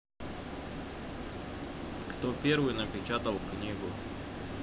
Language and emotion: Russian, neutral